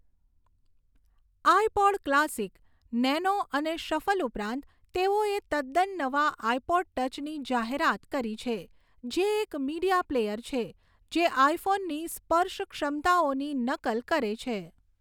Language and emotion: Gujarati, neutral